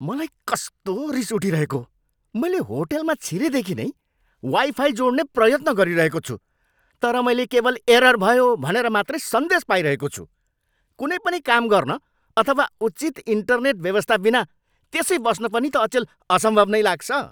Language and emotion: Nepali, angry